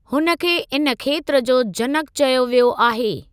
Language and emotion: Sindhi, neutral